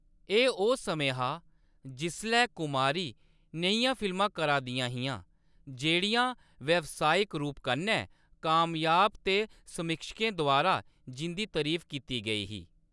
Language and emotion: Dogri, neutral